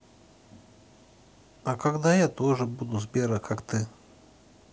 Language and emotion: Russian, neutral